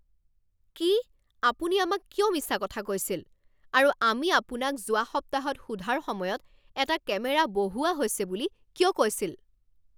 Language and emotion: Assamese, angry